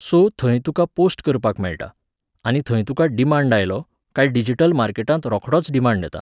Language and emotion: Goan Konkani, neutral